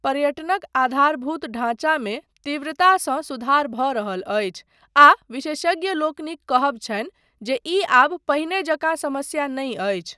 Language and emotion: Maithili, neutral